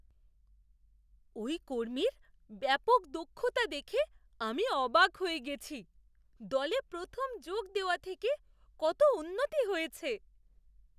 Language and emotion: Bengali, surprised